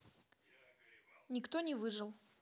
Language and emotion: Russian, neutral